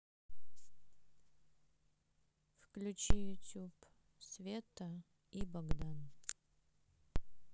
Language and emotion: Russian, sad